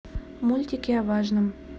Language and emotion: Russian, neutral